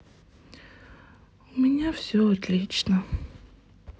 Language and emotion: Russian, sad